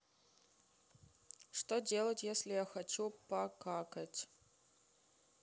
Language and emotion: Russian, neutral